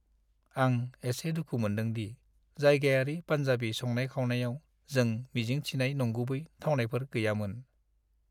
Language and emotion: Bodo, sad